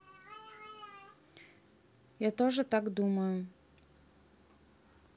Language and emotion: Russian, neutral